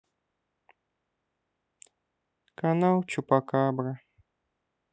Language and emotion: Russian, sad